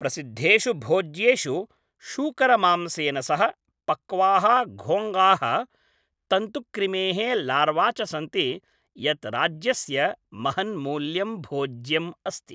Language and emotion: Sanskrit, neutral